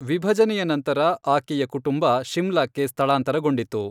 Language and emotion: Kannada, neutral